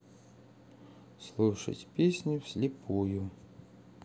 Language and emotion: Russian, neutral